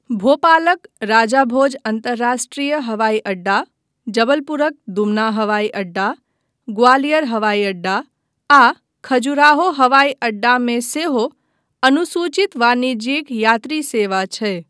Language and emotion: Maithili, neutral